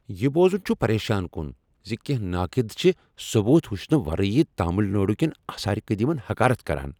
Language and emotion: Kashmiri, angry